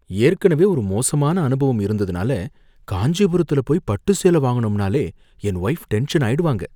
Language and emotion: Tamil, fearful